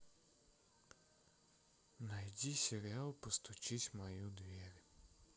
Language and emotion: Russian, sad